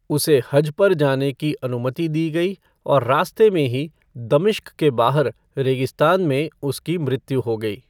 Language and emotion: Hindi, neutral